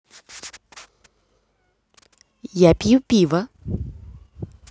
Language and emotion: Russian, positive